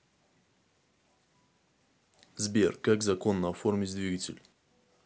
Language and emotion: Russian, neutral